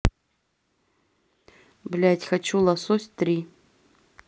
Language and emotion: Russian, neutral